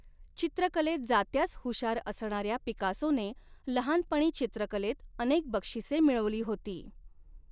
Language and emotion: Marathi, neutral